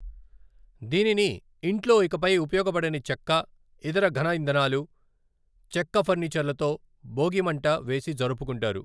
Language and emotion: Telugu, neutral